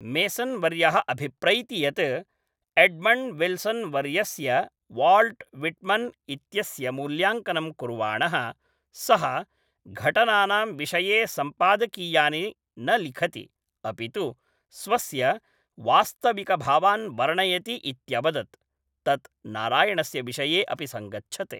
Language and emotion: Sanskrit, neutral